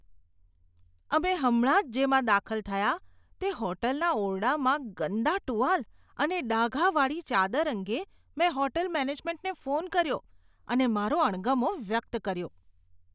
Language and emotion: Gujarati, disgusted